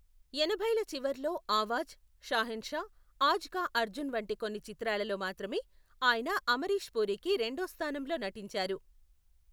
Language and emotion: Telugu, neutral